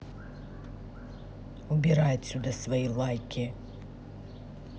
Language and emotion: Russian, angry